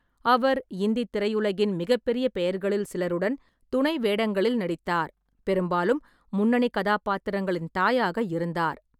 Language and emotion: Tamil, neutral